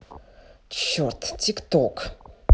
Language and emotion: Russian, angry